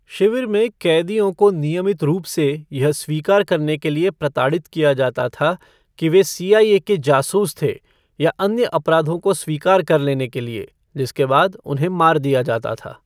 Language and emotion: Hindi, neutral